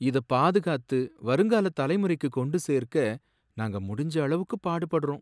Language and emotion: Tamil, sad